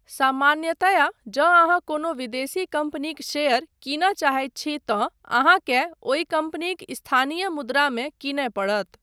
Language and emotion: Maithili, neutral